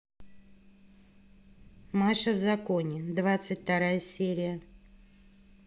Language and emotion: Russian, neutral